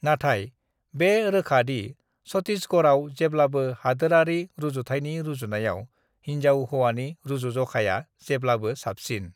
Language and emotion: Bodo, neutral